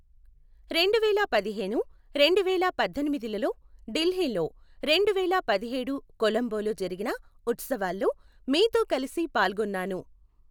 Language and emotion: Telugu, neutral